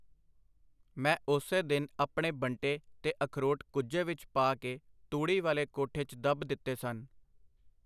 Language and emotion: Punjabi, neutral